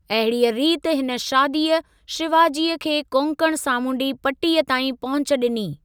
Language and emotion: Sindhi, neutral